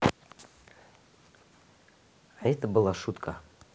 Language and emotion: Russian, neutral